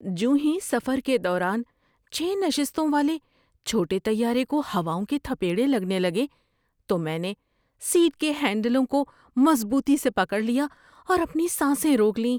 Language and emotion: Urdu, fearful